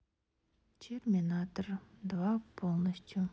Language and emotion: Russian, neutral